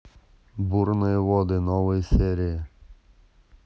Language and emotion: Russian, neutral